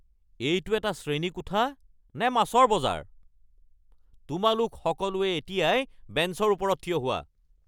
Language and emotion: Assamese, angry